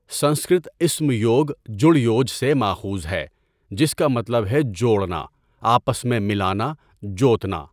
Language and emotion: Urdu, neutral